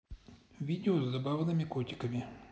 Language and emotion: Russian, neutral